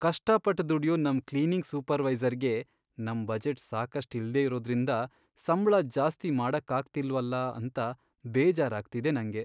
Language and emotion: Kannada, sad